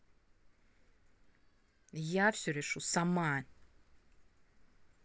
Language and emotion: Russian, angry